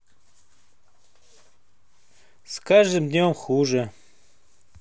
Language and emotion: Russian, sad